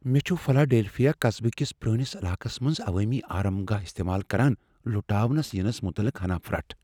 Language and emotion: Kashmiri, fearful